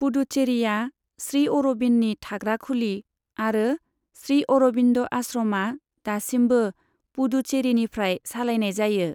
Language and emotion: Bodo, neutral